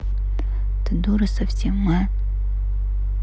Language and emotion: Russian, angry